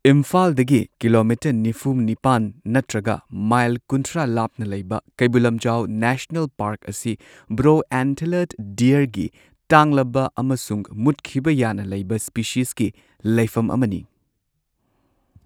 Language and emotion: Manipuri, neutral